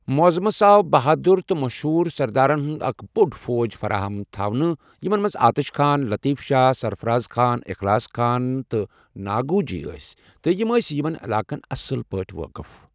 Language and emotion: Kashmiri, neutral